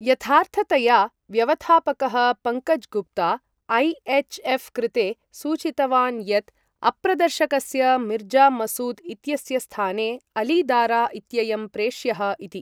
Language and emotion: Sanskrit, neutral